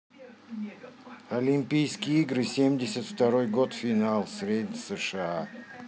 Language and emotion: Russian, neutral